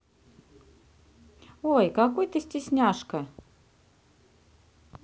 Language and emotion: Russian, neutral